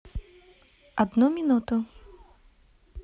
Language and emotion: Russian, neutral